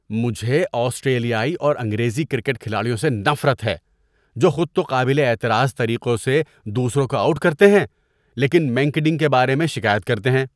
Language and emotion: Urdu, disgusted